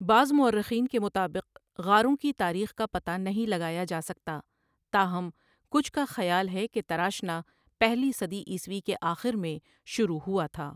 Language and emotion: Urdu, neutral